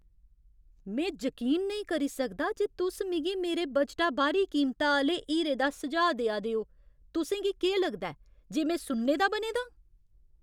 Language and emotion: Dogri, angry